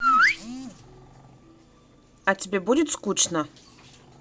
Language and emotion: Russian, neutral